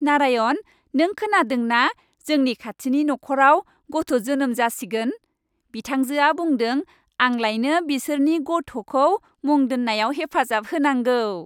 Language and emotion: Bodo, happy